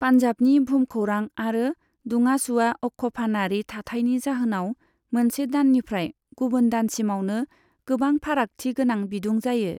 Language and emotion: Bodo, neutral